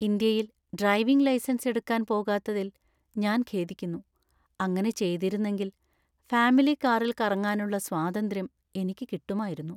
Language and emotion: Malayalam, sad